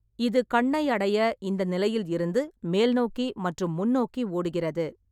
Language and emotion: Tamil, neutral